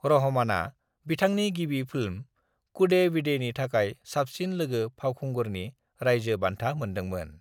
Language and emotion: Bodo, neutral